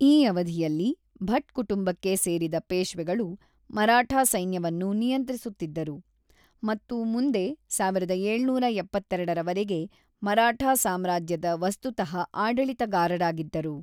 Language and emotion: Kannada, neutral